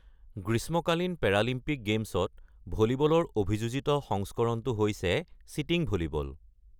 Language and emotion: Assamese, neutral